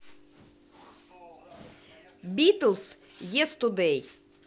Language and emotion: Russian, positive